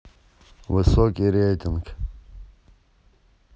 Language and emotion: Russian, neutral